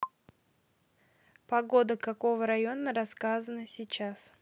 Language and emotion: Russian, neutral